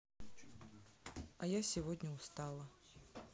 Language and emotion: Russian, neutral